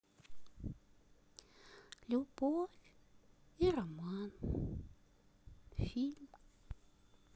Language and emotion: Russian, sad